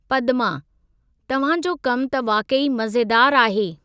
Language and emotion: Sindhi, neutral